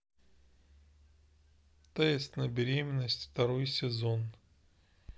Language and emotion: Russian, neutral